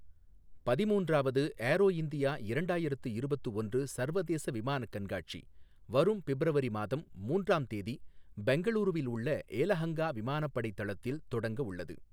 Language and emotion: Tamil, neutral